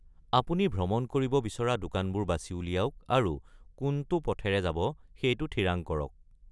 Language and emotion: Assamese, neutral